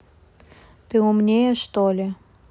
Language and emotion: Russian, neutral